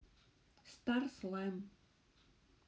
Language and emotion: Russian, neutral